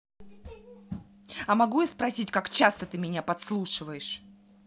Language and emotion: Russian, angry